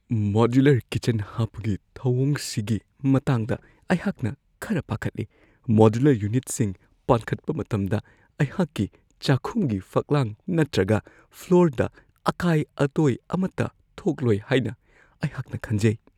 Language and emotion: Manipuri, fearful